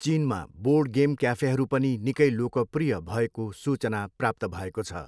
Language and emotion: Nepali, neutral